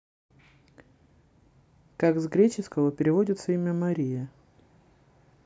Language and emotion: Russian, neutral